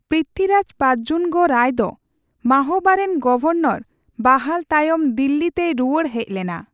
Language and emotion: Santali, neutral